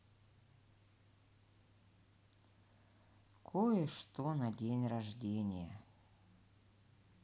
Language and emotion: Russian, sad